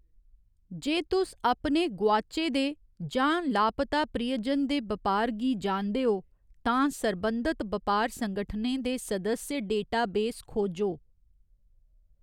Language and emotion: Dogri, neutral